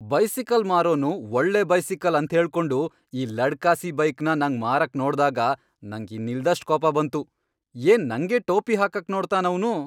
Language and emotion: Kannada, angry